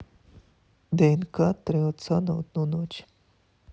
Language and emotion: Russian, neutral